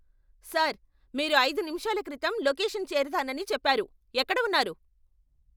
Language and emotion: Telugu, angry